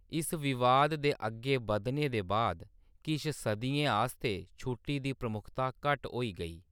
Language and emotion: Dogri, neutral